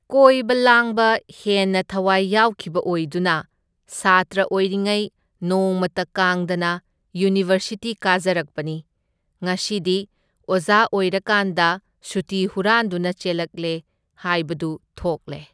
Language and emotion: Manipuri, neutral